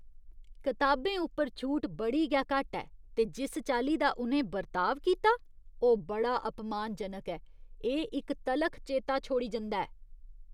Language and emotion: Dogri, disgusted